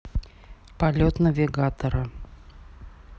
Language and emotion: Russian, neutral